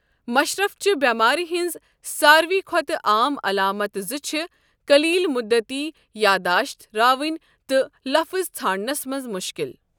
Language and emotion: Kashmiri, neutral